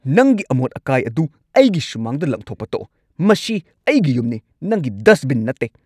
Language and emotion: Manipuri, angry